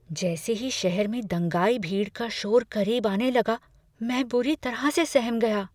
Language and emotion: Hindi, fearful